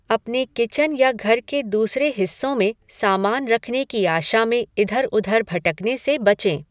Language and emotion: Hindi, neutral